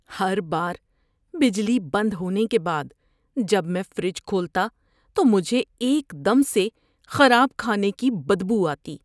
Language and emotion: Urdu, disgusted